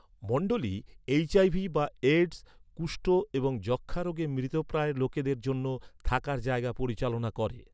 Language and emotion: Bengali, neutral